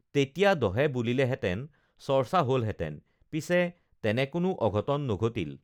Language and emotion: Assamese, neutral